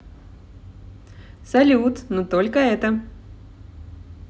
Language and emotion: Russian, positive